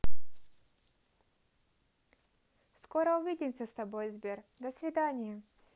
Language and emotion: Russian, positive